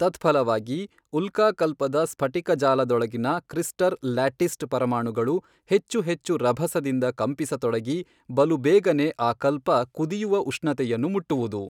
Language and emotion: Kannada, neutral